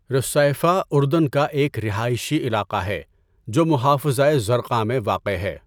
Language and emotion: Urdu, neutral